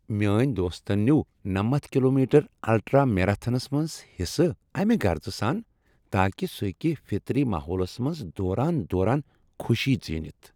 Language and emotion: Kashmiri, happy